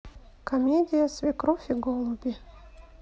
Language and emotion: Russian, neutral